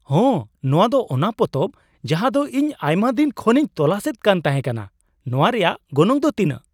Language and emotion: Santali, surprised